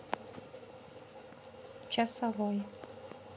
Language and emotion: Russian, neutral